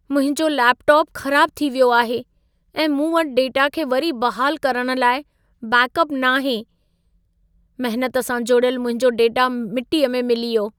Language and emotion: Sindhi, sad